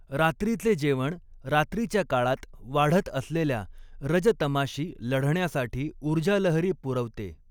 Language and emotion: Marathi, neutral